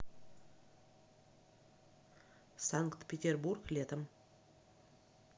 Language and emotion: Russian, neutral